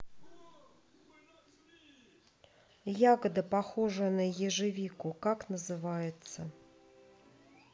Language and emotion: Russian, neutral